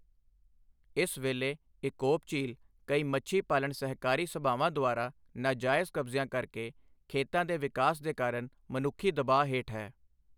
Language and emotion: Punjabi, neutral